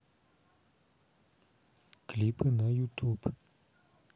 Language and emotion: Russian, neutral